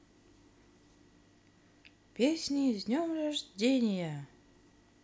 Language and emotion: Russian, positive